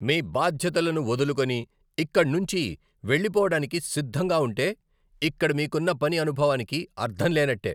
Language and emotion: Telugu, angry